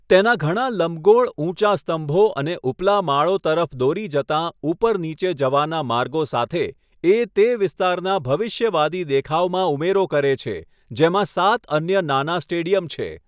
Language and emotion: Gujarati, neutral